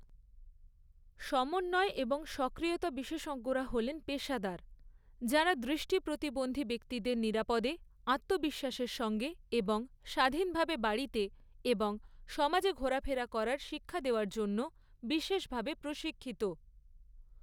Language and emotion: Bengali, neutral